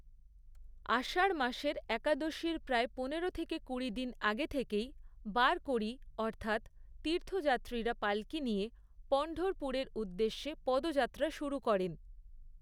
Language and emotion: Bengali, neutral